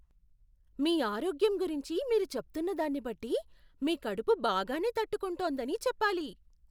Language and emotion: Telugu, surprised